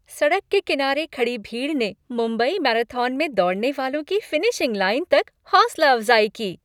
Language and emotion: Hindi, happy